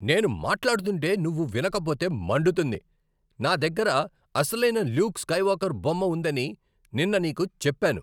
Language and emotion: Telugu, angry